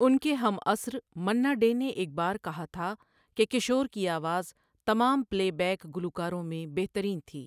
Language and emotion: Urdu, neutral